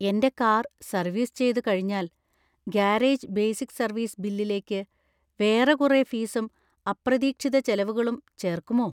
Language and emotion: Malayalam, fearful